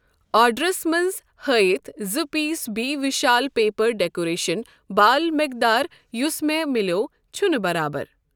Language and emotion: Kashmiri, neutral